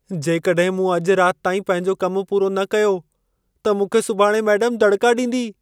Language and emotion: Sindhi, fearful